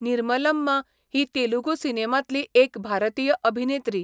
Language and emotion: Goan Konkani, neutral